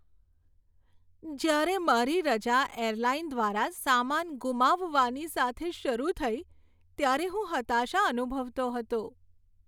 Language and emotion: Gujarati, sad